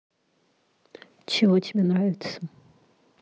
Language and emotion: Russian, neutral